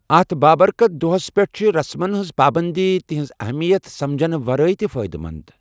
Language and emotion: Kashmiri, neutral